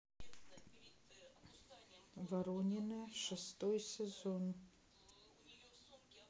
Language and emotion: Russian, neutral